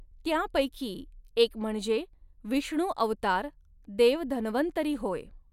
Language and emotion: Marathi, neutral